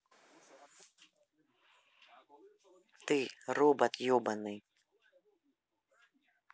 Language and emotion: Russian, angry